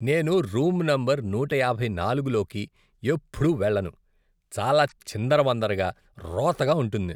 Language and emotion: Telugu, disgusted